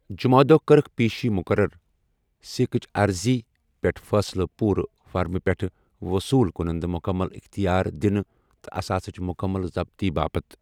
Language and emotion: Kashmiri, neutral